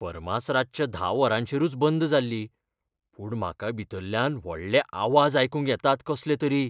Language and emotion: Goan Konkani, fearful